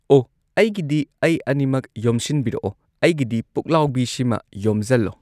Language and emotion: Manipuri, neutral